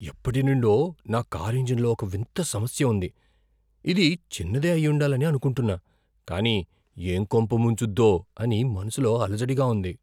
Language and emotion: Telugu, fearful